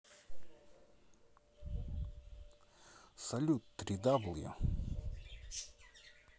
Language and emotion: Russian, neutral